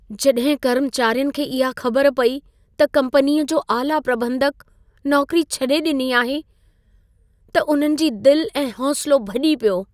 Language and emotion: Sindhi, sad